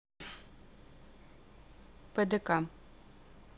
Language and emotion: Russian, neutral